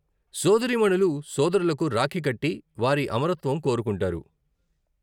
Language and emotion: Telugu, neutral